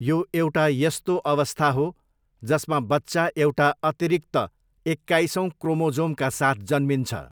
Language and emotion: Nepali, neutral